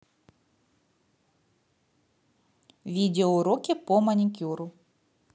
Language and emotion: Russian, neutral